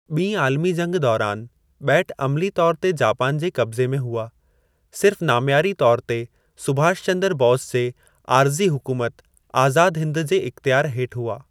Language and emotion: Sindhi, neutral